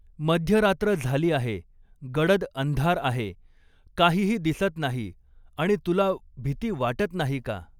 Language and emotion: Marathi, neutral